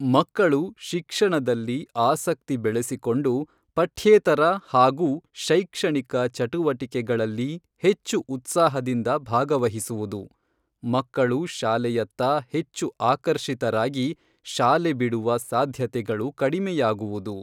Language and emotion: Kannada, neutral